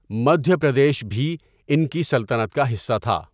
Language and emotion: Urdu, neutral